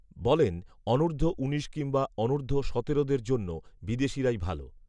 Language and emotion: Bengali, neutral